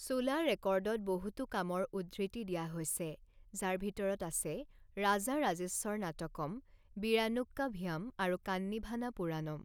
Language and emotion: Assamese, neutral